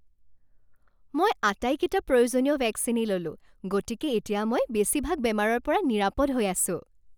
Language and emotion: Assamese, happy